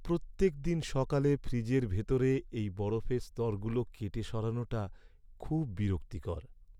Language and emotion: Bengali, sad